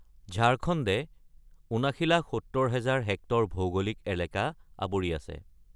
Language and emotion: Assamese, neutral